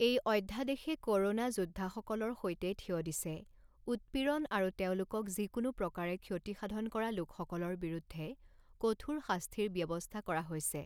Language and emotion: Assamese, neutral